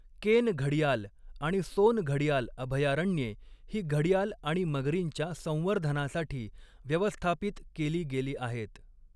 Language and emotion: Marathi, neutral